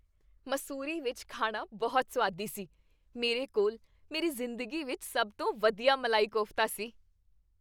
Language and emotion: Punjabi, happy